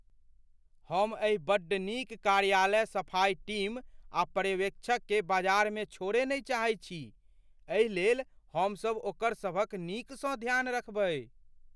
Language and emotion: Maithili, fearful